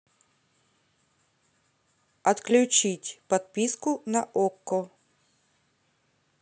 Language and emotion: Russian, neutral